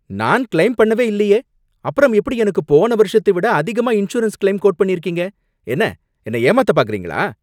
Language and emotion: Tamil, angry